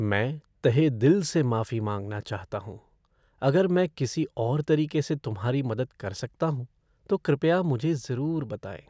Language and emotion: Hindi, sad